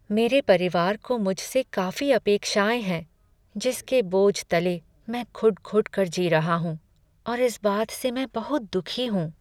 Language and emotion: Hindi, sad